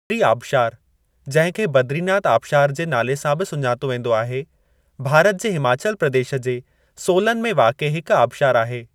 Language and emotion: Sindhi, neutral